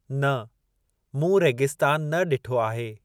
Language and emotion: Sindhi, neutral